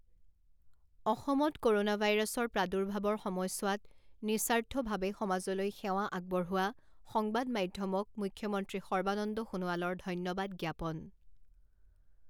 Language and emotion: Assamese, neutral